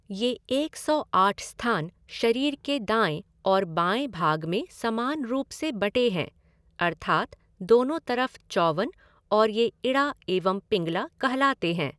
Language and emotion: Hindi, neutral